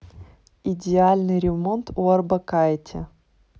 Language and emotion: Russian, neutral